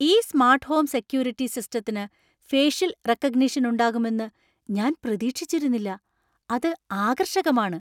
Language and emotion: Malayalam, surprised